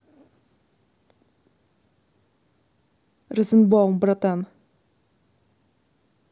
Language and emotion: Russian, neutral